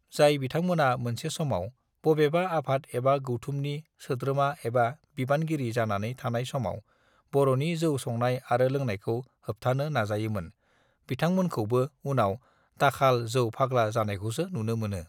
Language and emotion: Bodo, neutral